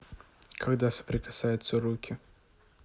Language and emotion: Russian, neutral